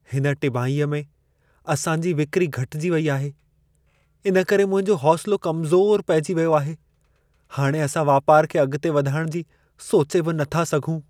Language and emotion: Sindhi, sad